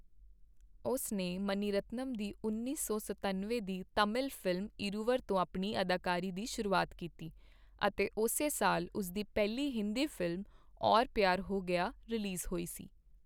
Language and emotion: Punjabi, neutral